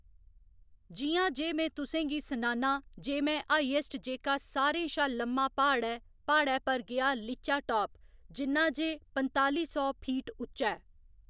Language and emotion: Dogri, neutral